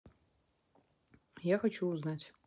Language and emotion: Russian, neutral